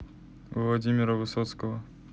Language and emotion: Russian, neutral